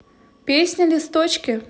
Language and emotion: Russian, positive